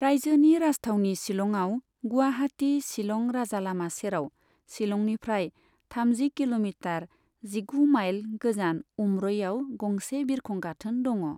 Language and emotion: Bodo, neutral